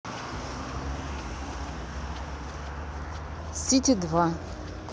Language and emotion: Russian, neutral